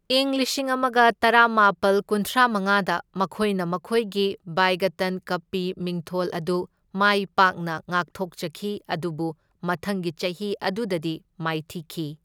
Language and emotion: Manipuri, neutral